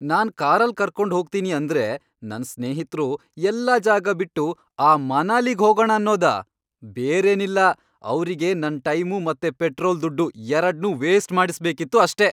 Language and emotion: Kannada, angry